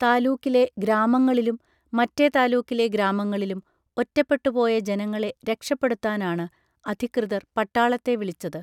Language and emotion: Malayalam, neutral